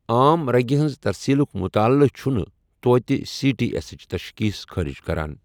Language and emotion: Kashmiri, neutral